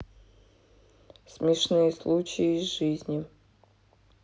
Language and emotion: Russian, sad